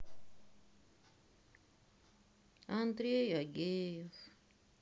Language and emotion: Russian, sad